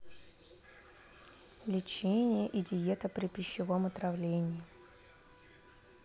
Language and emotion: Russian, neutral